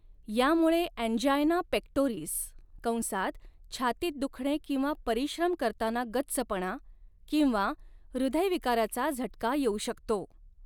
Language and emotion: Marathi, neutral